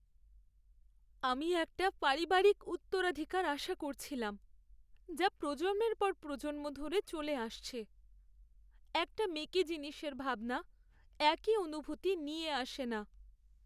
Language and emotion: Bengali, sad